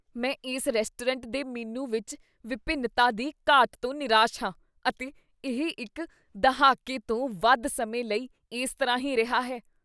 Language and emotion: Punjabi, disgusted